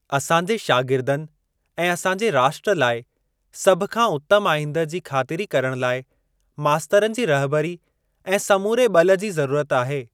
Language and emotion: Sindhi, neutral